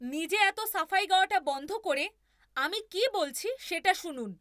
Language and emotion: Bengali, angry